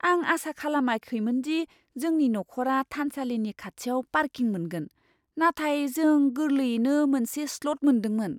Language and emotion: Bodo, surprised